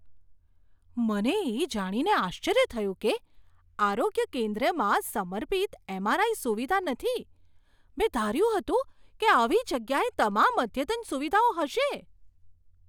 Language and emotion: Gujarati, surprised